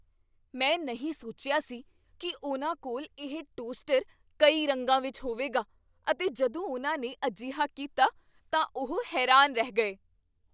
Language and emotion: Punjabi, surprised